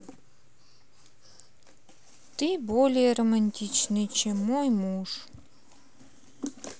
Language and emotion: Russian, neutral